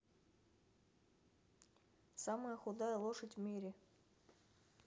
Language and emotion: Russian, neutral